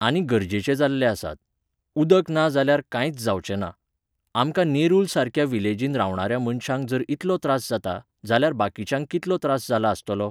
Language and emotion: Goan Konkani, neutral